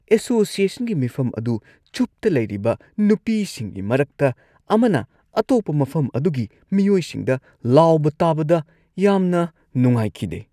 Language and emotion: Manipuri, disgusted